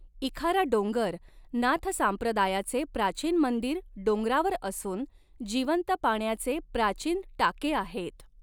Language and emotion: Marathi, neutral